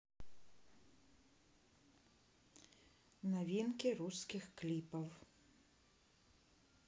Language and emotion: Russian, neutral